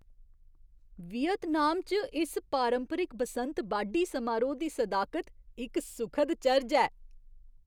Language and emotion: Dogri, surprised